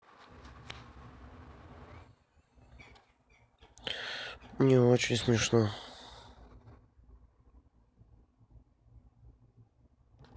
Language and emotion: Russian, sad